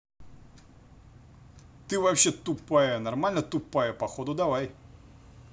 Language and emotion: Russian, angry